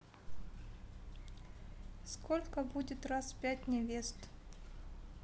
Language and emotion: Russian, neutral